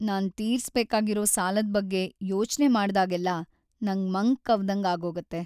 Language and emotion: Kannada, sad